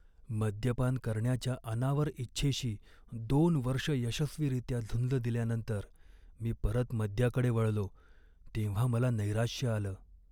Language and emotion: Marathi, sad